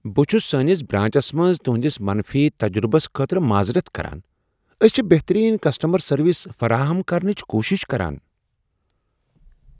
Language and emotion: Kashmiri, surprised